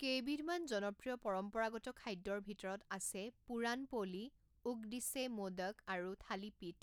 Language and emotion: Assamese, neutral